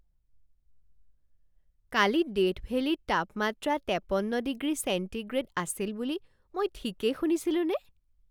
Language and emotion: Assamese, surprised